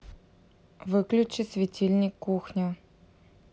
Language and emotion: Russian, neutral